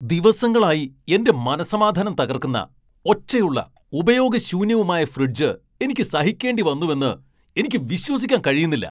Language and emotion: Malayalam, angry